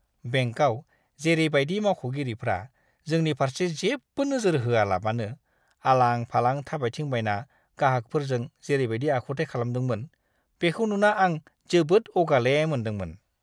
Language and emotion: Bodo, disgusted